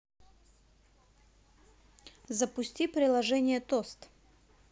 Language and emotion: Russian, positive